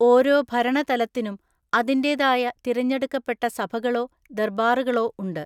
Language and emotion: Malayalam, neutral